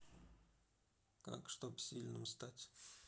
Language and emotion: Russian, neutral